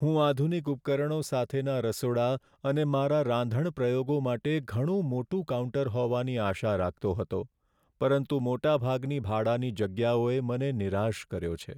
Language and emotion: Gujarati, sad